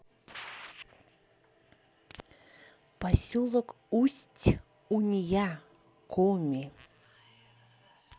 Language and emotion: Russian, neutral